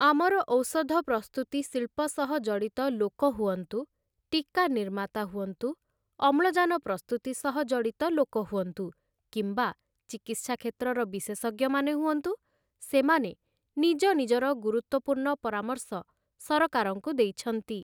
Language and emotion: Odia, neutral